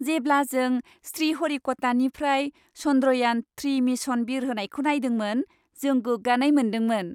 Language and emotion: Bodo, happy